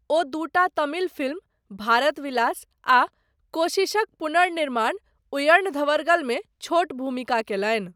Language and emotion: Maithili, neutral